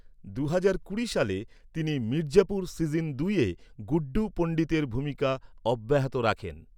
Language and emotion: Bengali, neutral